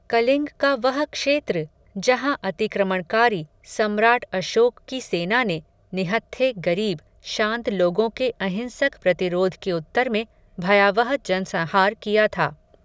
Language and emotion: Hindi, neutral